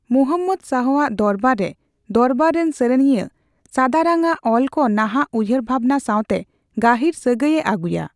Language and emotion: Santali, neutral